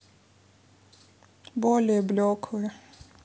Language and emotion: Russian, sad